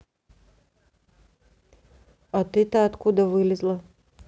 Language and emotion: Russian, neutral